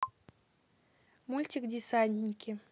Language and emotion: Russian, neutral